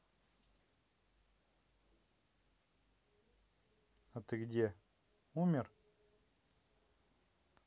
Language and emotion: Russian, neutral